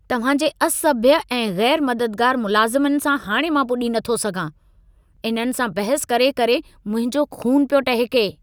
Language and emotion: Sindhi, angry